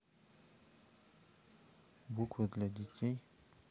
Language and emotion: Russian, neutral